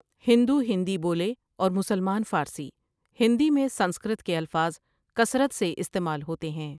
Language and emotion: Urdu, neutral